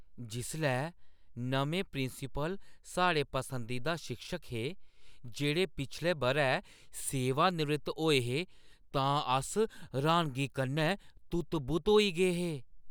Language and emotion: Dogri, surprised